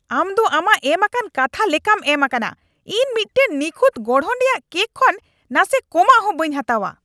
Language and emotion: Santali, angry